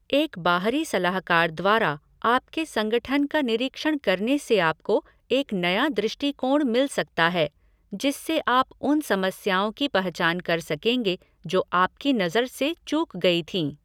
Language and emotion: Hindi, neutral